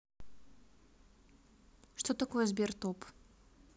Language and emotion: Russian, neutral